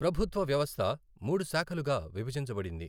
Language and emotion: Telugu, neutral